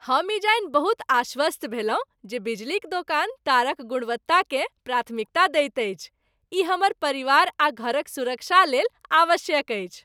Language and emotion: Maithili, happy